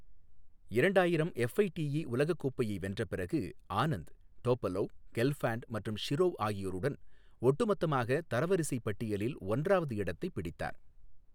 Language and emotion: Tamil, neutral